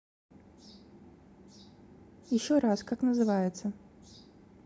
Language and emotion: Russian, neutral